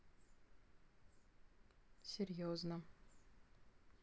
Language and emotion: Russian, neutral